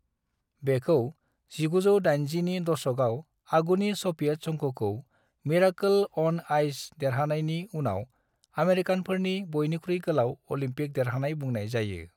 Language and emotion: Bodo, neutral